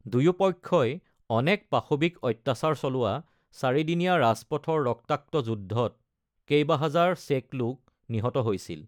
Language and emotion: Assamese, neutral